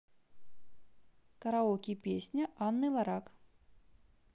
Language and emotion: Russian, neutral